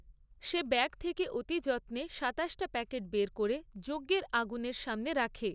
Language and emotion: Bengali, neutral